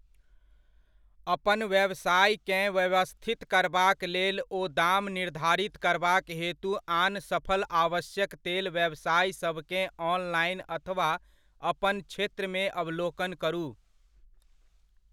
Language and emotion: Maithili, neutral